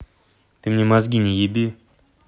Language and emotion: Russian, angry